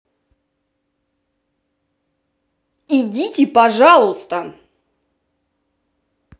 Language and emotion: Russian, angry